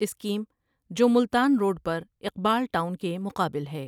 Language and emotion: Urdu, neutral